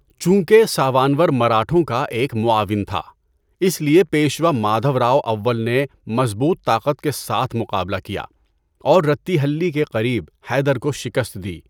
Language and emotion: Urdu, neutral